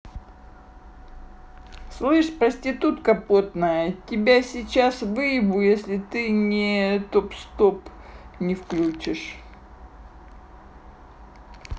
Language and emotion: Russian, angry